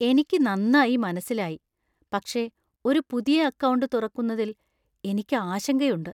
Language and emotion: Malayalam, fearful